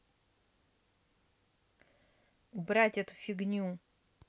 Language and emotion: Russian, angry